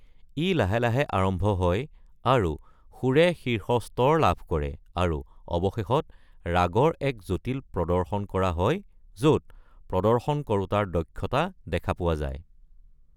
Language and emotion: Assamese, neutral